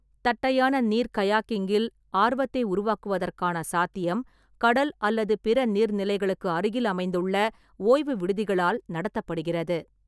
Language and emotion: Tamil, neutral